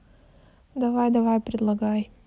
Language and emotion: Russian, neutral